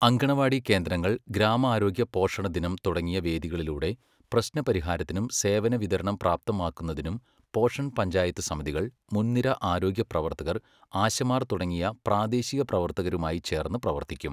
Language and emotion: Malayalam, neutral